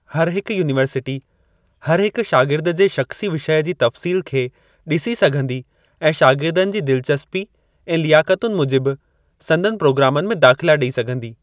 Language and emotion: Sindhi, neutral